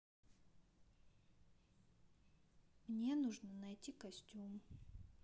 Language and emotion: Russian, neutral